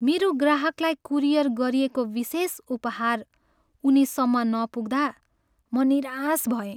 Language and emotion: Nepali, sad